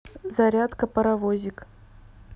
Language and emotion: Russian, neutral